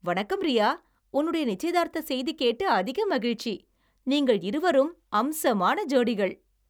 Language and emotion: Tamil, happy